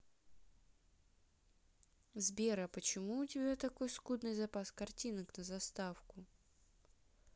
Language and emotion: Russian, neutral